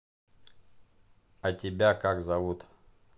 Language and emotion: Russian, neutral